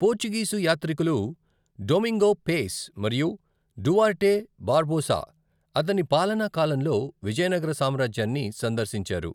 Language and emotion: Telugu, neutral